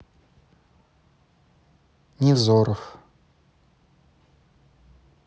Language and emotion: Russian, neutral